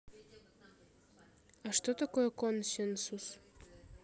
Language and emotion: Russian, neutral